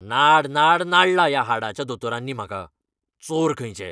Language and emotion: Goan Konkani, angry